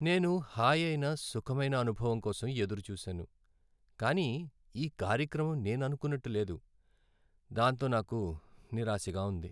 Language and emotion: Telugu, sad